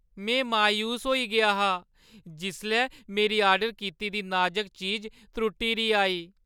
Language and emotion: Dogri, sad